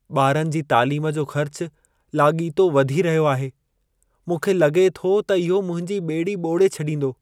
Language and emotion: Sindhi, sad